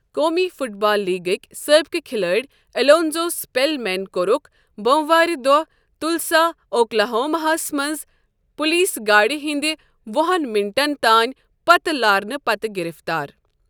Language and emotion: Kashmiri, neutral